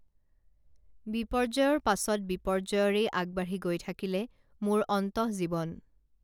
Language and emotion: Assamese, neutral